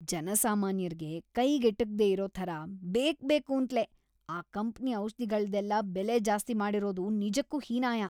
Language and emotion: Kannada, disgusted